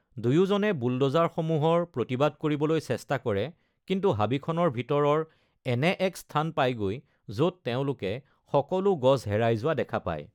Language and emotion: Assamese, neutral